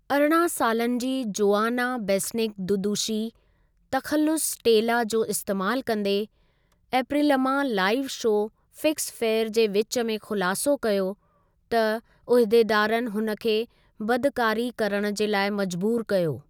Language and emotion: Sindhi, neutral